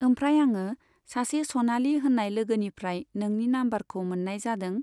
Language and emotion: Bodo, neutral